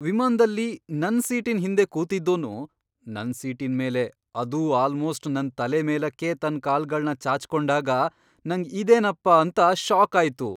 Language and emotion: Kannada, surprised